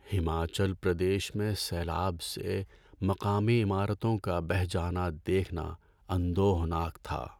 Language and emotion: Urdu, sad